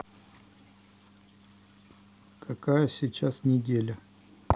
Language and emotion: Russian, neutral